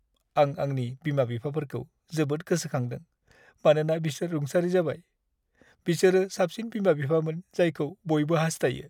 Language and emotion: Bodo, sad